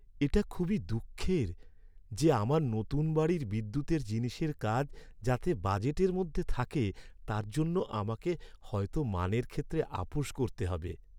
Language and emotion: Bengali, sad